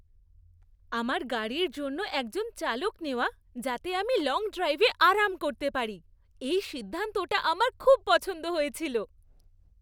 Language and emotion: Bengali, happy